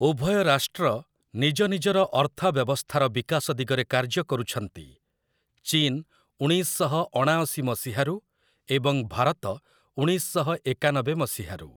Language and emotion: Odia, neutral